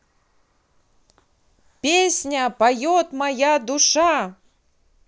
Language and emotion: Russian, positive